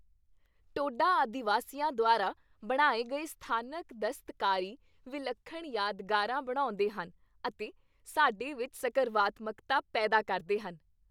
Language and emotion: Punjabi, happy